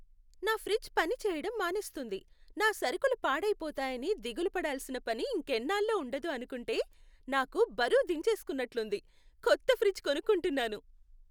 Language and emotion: Telugu, happy